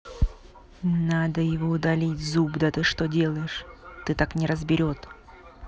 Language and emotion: Russian, angry